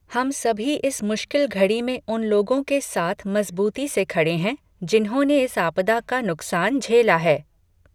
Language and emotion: Hindi, neutral